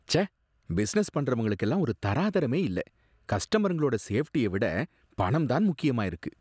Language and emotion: Tamil, disgusted